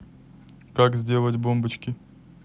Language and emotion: Russian, neutral